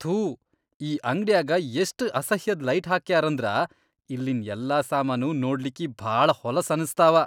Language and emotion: Kannada, disgusted